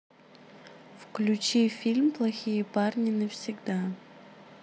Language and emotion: Russian, neutral